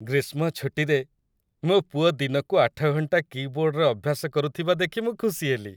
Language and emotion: Odia, happy